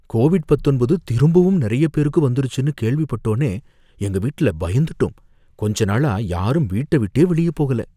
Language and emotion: Tamil, fearful